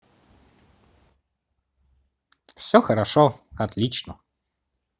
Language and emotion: Russian, positive